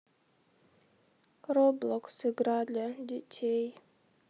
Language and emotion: Russian, sad